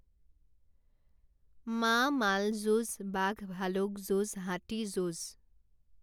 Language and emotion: Assamese, neutral